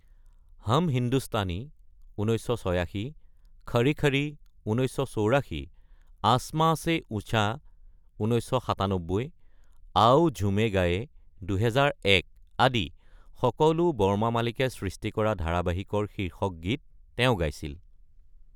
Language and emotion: Assamese, neutral